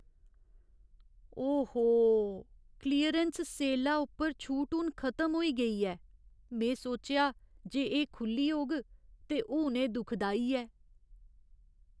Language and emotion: Dogri, sad